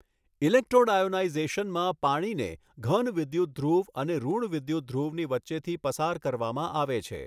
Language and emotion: Gujarati, neutral